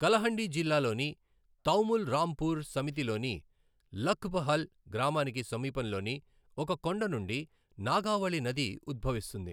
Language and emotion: Telugu, neutral